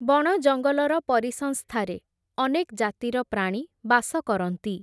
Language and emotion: Odia, neutral